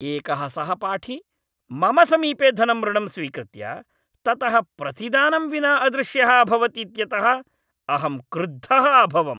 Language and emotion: Sanskrit, angry